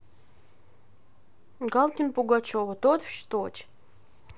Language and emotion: Russian, neutral